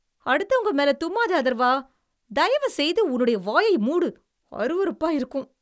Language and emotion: Tamil, disgusted